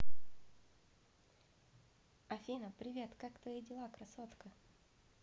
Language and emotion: Russian, positive